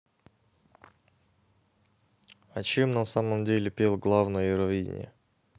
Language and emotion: Russian, neutral